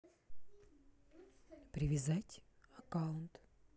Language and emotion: Russian, neutral